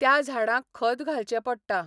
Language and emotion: Goan Konkani, neutral